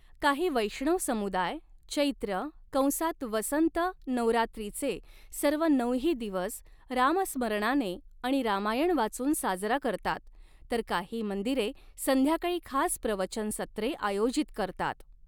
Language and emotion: Marathi, neutral